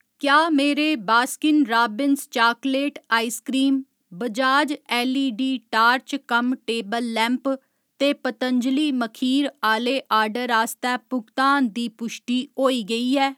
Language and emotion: Dogri, neutral